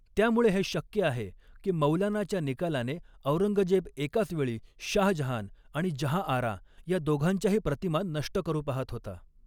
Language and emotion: Marathi, neutral